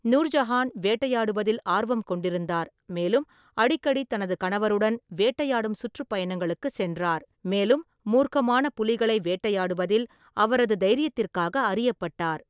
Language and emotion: Tamil, neutral